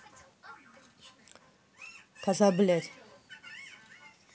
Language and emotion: Russian, angry